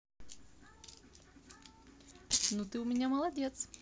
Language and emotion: Russian, positive